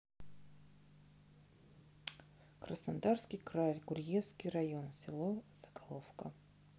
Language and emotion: Russian, neutral